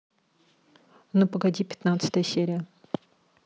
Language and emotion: Russian, neutral